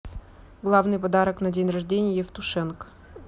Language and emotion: Russian, neutral